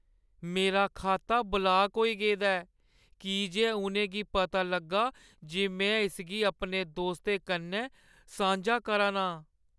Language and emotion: Dogri, sad